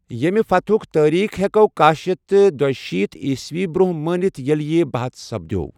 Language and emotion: Kashmiri, neutral